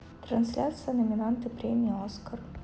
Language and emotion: Russian, neutral